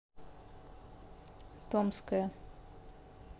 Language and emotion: Russian, neutral